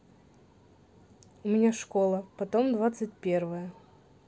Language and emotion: Russian, neutral